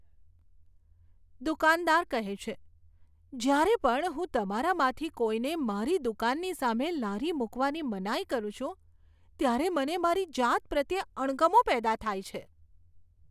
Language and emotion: Gujarati, disgusted